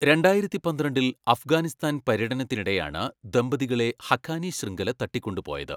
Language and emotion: Malayalam, neutral